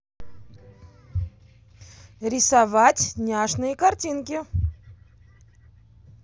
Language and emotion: Russian, positive